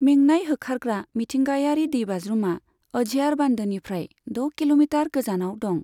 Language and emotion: Bodo, neutral